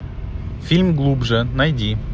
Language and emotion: Russian, neutral